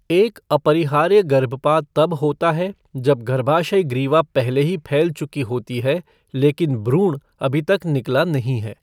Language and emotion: Hindi, neutral